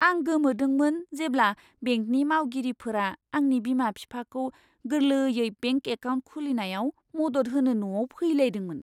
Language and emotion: Bodo, surprised